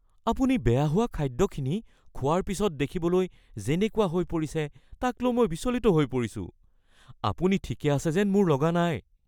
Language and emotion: Assamese, fearful